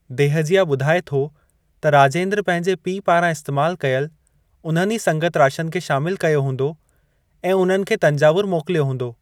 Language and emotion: Sindhi, neutral